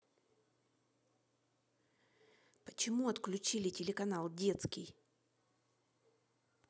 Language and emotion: Russian, angry